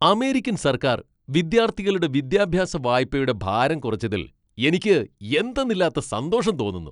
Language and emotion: Malayalam, happy